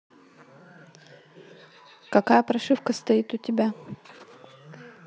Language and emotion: Russian, neutral